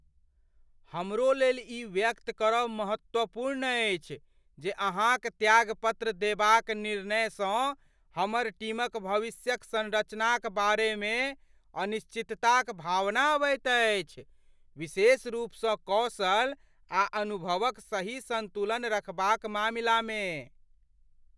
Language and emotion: Maithili, fearful